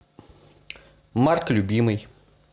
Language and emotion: Russian, neutral